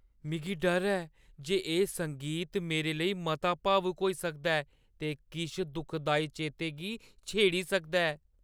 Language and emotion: Dogri, fearful